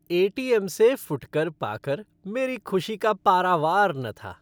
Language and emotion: Hindi, happy